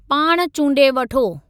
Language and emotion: Sindhi, neutral